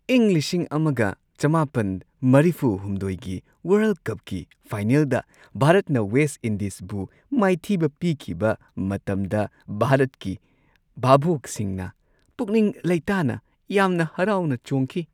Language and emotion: Manipuri, happy